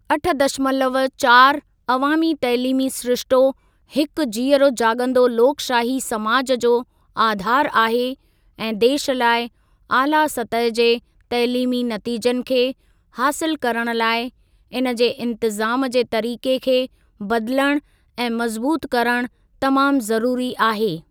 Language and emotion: Sindhi, neutral